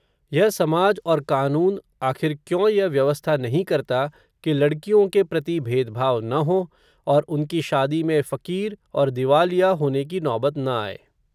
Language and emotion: Hindi, neutral